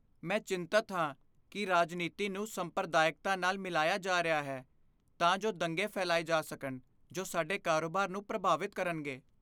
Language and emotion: Punjabi, fearful